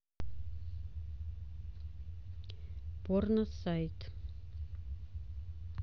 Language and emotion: Russian, neutral